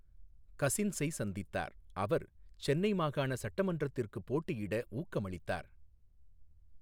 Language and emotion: Tamil, neutral